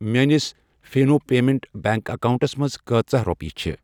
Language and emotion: Kashmiri, neutral